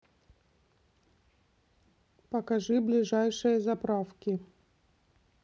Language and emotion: Russian, neutral